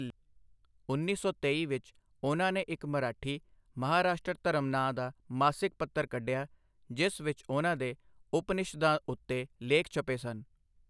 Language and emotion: Punjabi, neutral